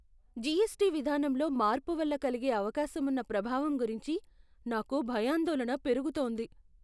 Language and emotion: Telugu, fearful